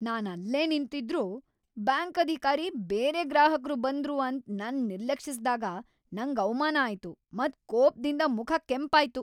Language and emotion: Kannada, angry